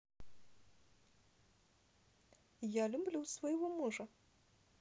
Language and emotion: Russian, positive